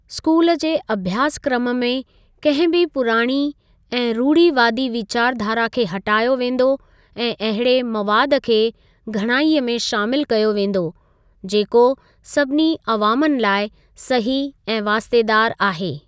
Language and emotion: Sindhi, neutral